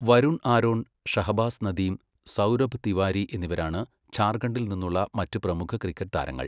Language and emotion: Malayalam, neutral